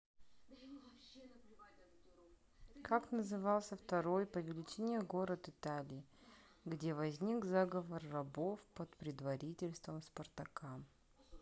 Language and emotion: Russian, neutral